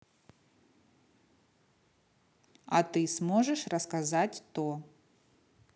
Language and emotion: Russian, neutral